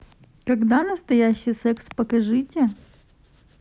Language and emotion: Russian, neutral